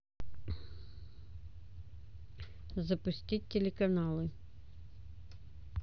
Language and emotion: Russian, neutral